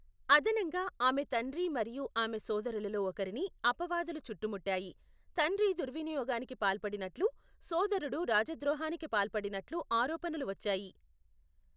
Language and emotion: Telugu, neutral